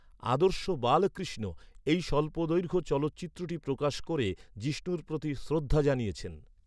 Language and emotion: Bengali, neutral